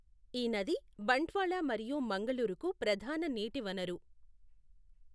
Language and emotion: Telugu, neutral